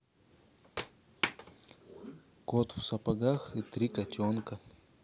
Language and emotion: Russian, neutral